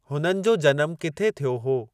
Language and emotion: Sindhi, neutral